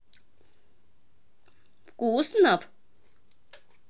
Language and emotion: Russian, positive